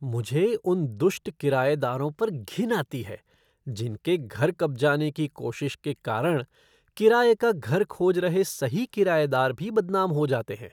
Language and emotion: Hindi, disgusted